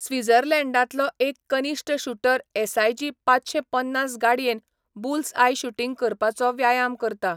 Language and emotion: Goan Konkani, neutral